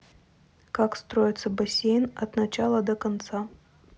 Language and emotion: Russian, neutral